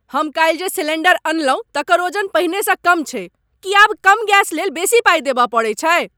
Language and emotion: Maithili, angry